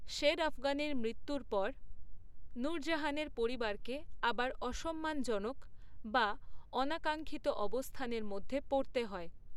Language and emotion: Bengali, neutral